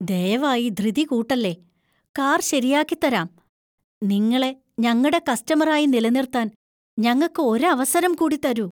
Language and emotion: Malayalam, fearful